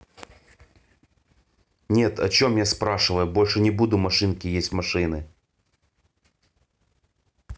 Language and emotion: Russian, angry